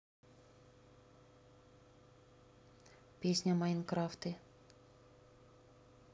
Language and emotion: Russian, neutral